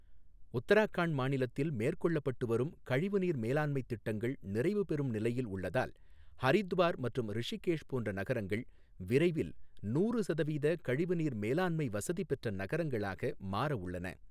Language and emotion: Tamil, neutral